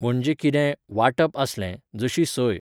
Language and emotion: Goan Konkani, neutral